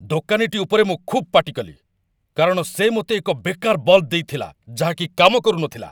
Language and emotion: Odia, angry